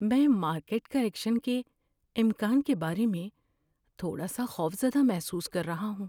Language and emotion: Urdu, fearful